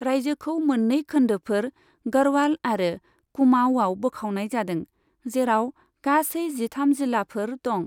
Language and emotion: Bodo, neutral